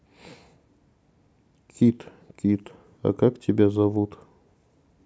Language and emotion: Russian, neutral